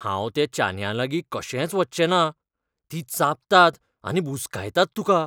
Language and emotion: Goan Konkani, fearful